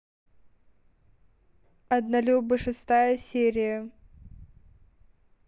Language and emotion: Russian, neutral